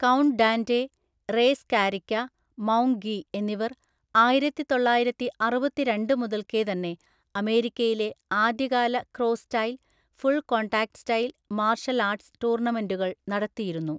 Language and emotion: Malayalam, neutral